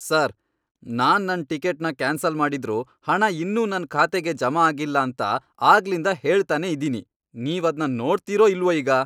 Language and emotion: Kannada, angry